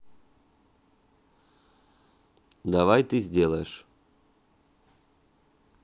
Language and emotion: Russian, neutral